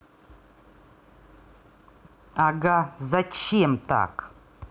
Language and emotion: Russian, angry